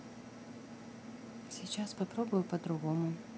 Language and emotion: Russian, neutral